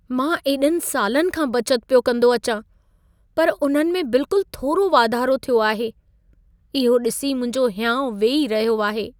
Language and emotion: Sindhi, sad